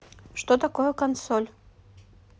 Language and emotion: Russian, neutral